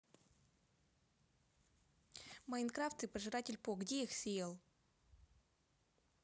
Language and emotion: Russian, neutral